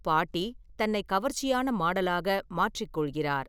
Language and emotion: Tamil, neutral